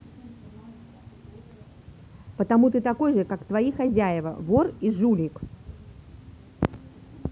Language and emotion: Russian, angry